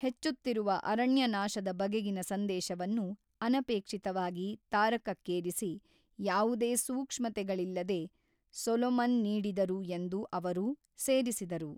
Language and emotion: Kannada, neutral